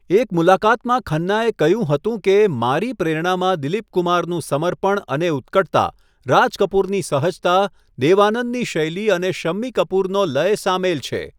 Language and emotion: Gujarati, neutral